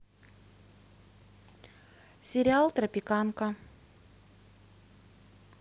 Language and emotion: Russian, neutral